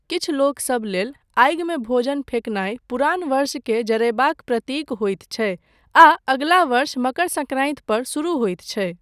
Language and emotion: Maithili, neutral